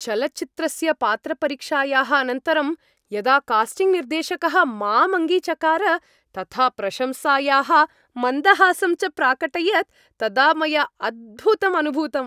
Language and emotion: Sanskrit, happy